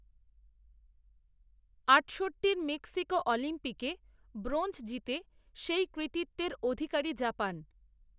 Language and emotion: Bengali, neutral